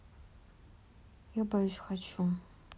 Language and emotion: Russian, sad